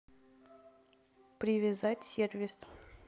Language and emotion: Russian, neutral